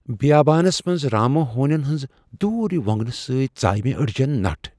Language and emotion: Kashmiri, fearful